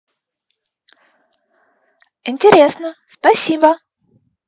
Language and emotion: Russian, positive